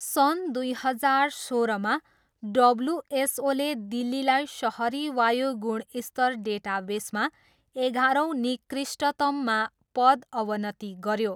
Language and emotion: Nepali, neutral